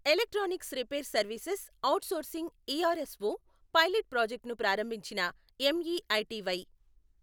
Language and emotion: Telugu, neutral